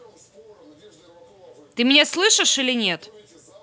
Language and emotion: Russian, angry